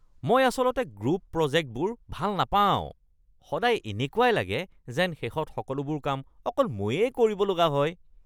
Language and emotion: Assamese, disgusted